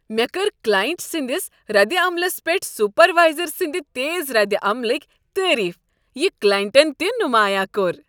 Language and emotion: Kashmiri, happy